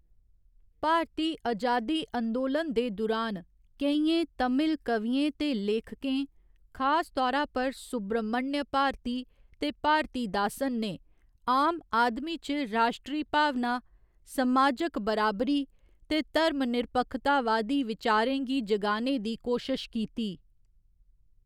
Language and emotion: Dogri, neutral